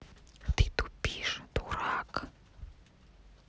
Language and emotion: Russian, angry